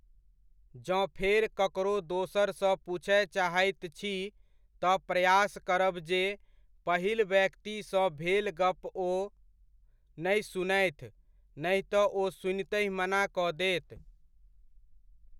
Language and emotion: Maithili, neutral